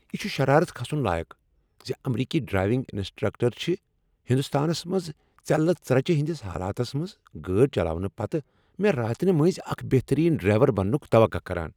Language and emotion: Kashmiri, angry